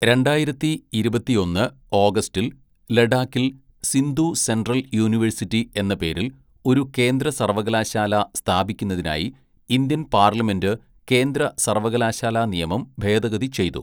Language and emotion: Malayalam, neutral